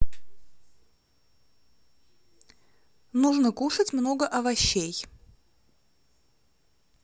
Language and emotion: Russian, neutral